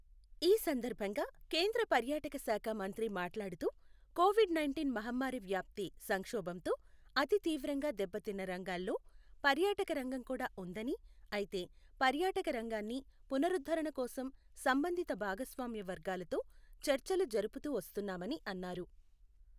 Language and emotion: Telugu, neutral